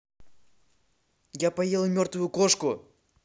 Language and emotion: Russian, angry